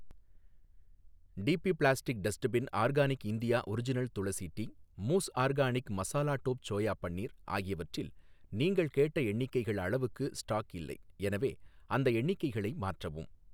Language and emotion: Tamil, neutral